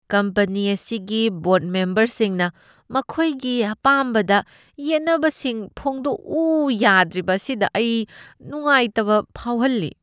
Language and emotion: Manipuri, disgusted